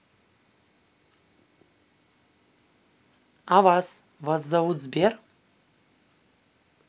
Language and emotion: Russian, neutral